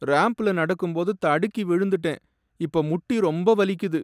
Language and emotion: Tamil, sad